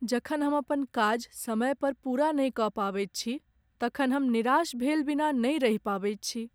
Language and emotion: Maithili, sad